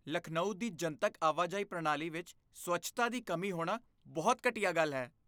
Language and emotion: Punjabi, disgusted